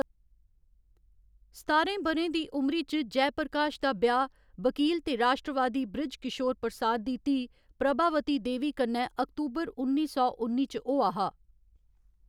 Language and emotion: Dogri, neutral